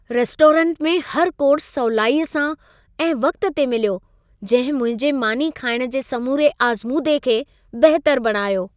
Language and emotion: Sindhi, happy